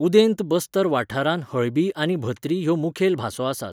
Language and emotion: Goan Konkani, neutral